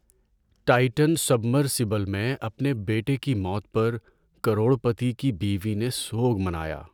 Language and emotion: Urdu, sad